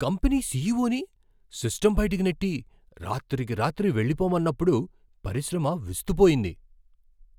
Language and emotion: Telugu, surprised